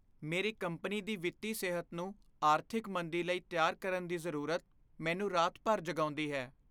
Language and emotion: Punjabi, fearful